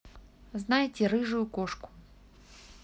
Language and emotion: Russian, neutral